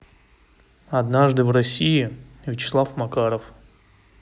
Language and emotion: Russian, neutral